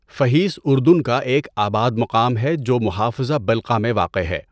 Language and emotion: Urdu, neutral